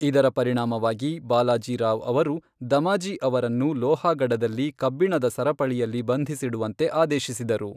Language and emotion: Kannada, neutral